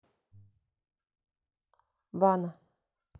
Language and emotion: Russian, neutral